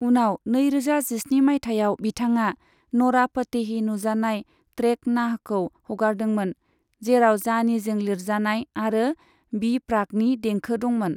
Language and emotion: Bodo, neutral